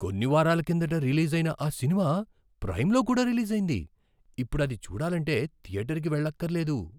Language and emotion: Telugu, surprised